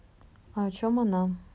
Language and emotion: Russian, neutral